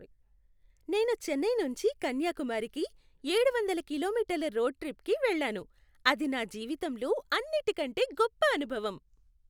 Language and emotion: Telugu, happy